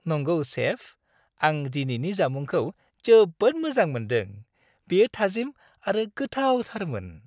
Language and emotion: Bodo, happy